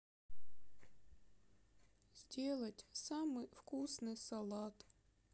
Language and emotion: Russian, sad